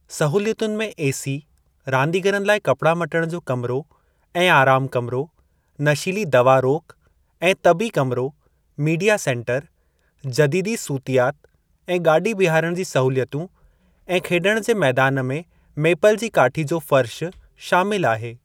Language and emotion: Sindhi, neutral